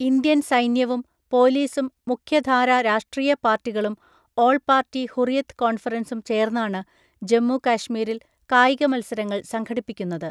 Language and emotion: Malayalam, neutral